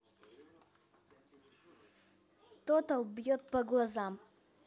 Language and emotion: Russian, neutral